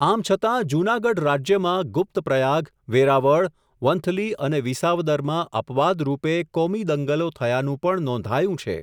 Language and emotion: Gujarati, neutral